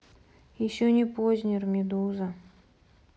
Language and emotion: Russian, sad